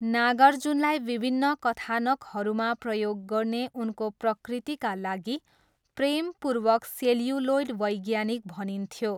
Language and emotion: Nepali, neutral